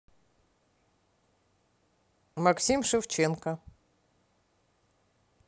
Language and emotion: Russian, neutral